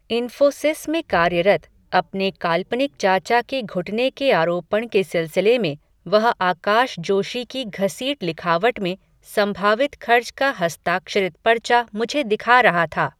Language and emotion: Hindi, neutral